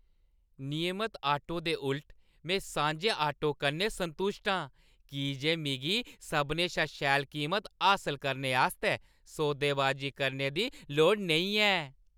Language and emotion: Dogri, happy